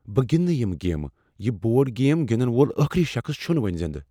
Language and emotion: Kashmiri, fearful